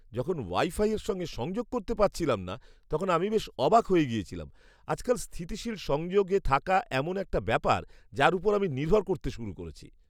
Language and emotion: Bengali, surprised